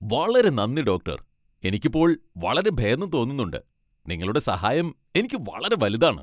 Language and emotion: Malayalam, happy